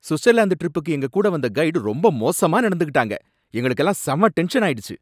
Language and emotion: Tamil, angry